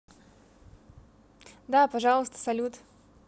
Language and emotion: Russian, positive